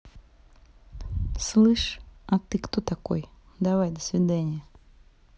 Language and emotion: Russian, angry